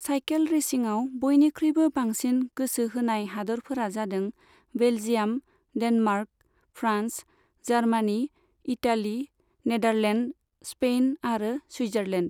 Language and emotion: Bodo, neutral